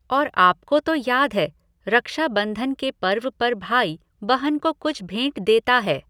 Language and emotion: Hindi, neutral